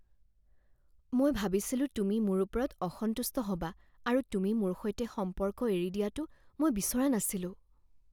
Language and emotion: Assamese, fearful